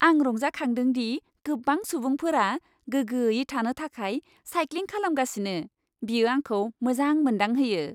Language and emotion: Bodo, happy